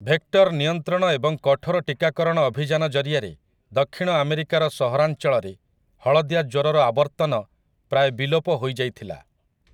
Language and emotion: Odia, neutral